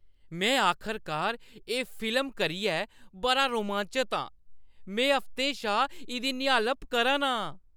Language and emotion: Dogri, happy